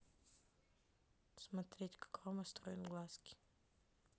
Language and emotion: Russian, neutral